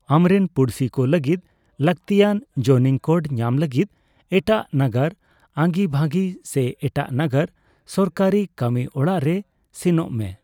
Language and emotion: Santali, neutral